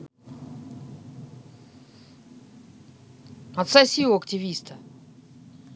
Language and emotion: Russian, angry